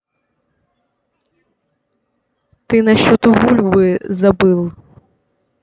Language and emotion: Russian, neutral